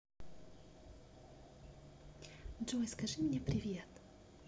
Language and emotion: Russian, positive